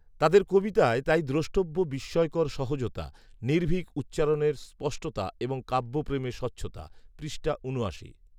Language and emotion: Bengali, neutral